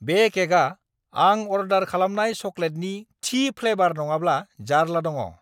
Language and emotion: Bodo, angry